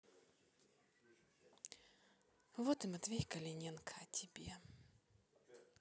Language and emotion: Russian, neutral